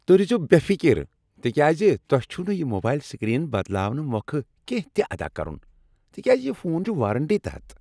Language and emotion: Kashmiri, happy